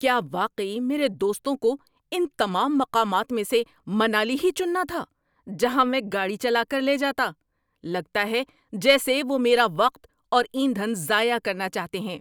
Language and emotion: Urdu, angry